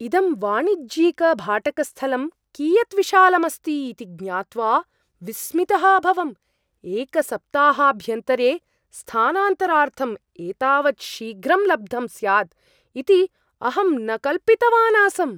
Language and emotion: Sanskrit, surprised